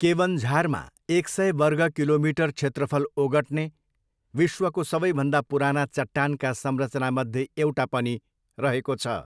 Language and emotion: Nepali, neutral